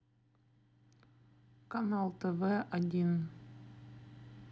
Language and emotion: Russian, neutral